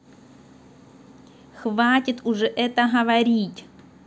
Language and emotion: Russian, angry